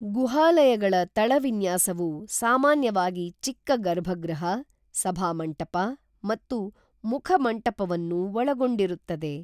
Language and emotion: Kannada, neutral